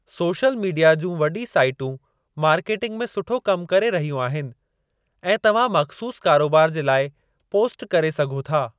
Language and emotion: Sindhi, neutral